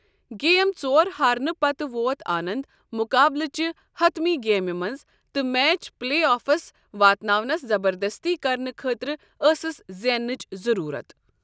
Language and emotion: Kashmiri, neutral